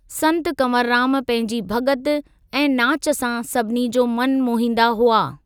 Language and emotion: Sindhi, neutral